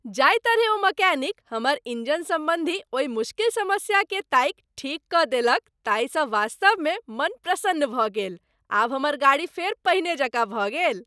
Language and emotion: Maithili, happy